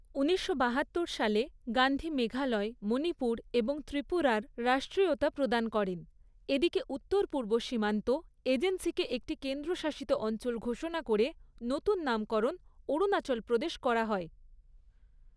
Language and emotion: Bengali, neutral